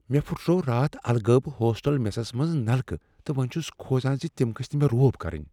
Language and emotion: Kashmiri, fearful